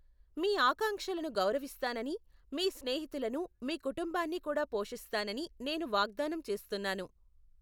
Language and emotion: Telugu, neutral